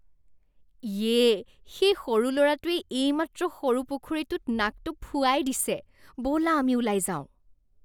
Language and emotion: Assamese, disgusted